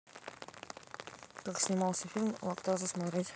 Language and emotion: Russian, neutral